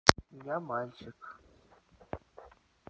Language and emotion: Russian, neutral